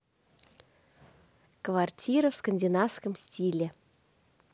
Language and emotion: Russian, positive